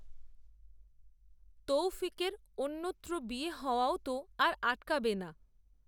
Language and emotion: Bengali, neutral